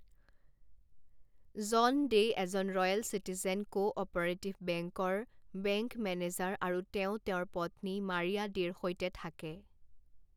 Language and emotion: Assamese, neutral